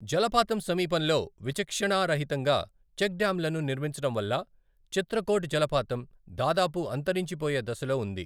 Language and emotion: Telugu, neutral